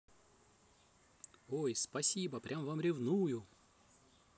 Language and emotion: Russian, positive